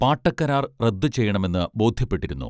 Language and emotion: Malayalam, neutral